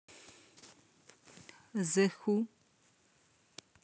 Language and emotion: Russian, neutral